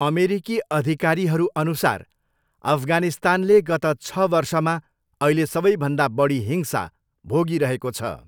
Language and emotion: Nepali, neutral